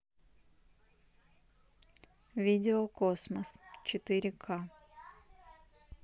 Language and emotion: Russian, neutral